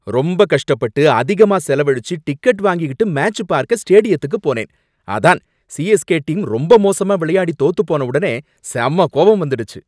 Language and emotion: Tamil, angry